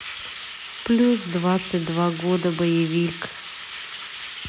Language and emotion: Russian, neutral